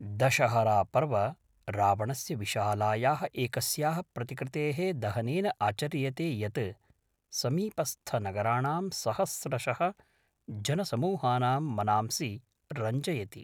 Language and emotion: Sanskrit, neutral